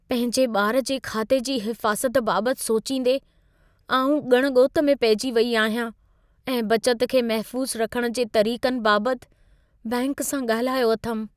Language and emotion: Sindhi, fearful